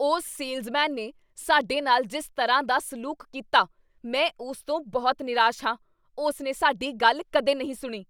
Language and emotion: Punjabi, angry